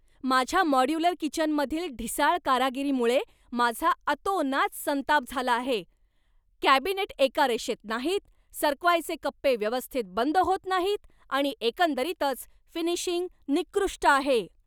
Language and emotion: Marathi, angry